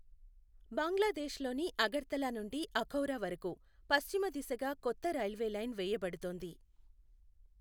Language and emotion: Telugu, neutral